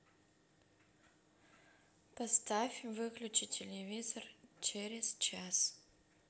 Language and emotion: Russian, neutral